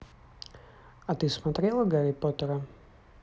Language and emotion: Russian, neutral